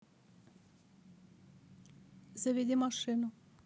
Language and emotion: Russian, neutral